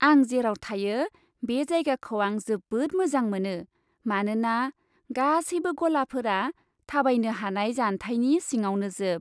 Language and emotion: Bodo, happy